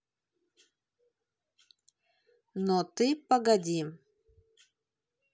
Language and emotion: Russian, neutral